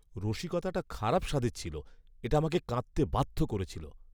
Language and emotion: Bengali, disgusted